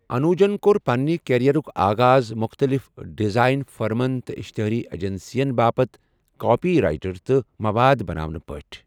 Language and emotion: Kashmiri, neutral